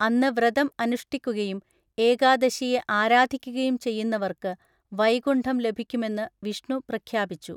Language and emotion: Malayalam, neutral